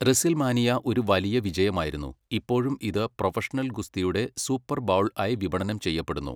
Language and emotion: Malayalam, neutral